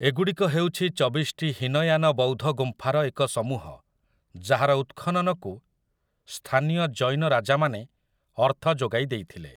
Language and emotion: Odia, neutral